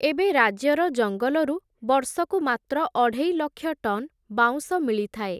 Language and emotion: Odia, neutral